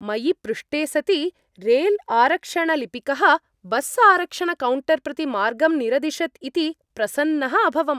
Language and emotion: Sanskrit, happy